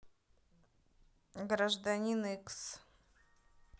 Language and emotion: Russian, neutral